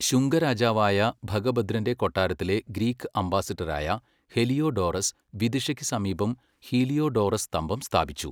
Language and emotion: Malayalam, neutral